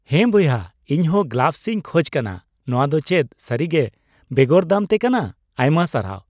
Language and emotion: Santali, happy